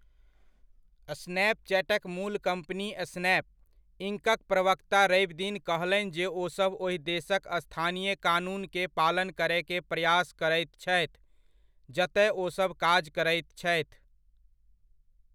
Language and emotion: Maithili, neutral